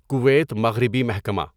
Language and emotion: Urdu, neutral